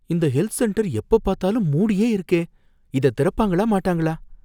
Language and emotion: Tamil, fearful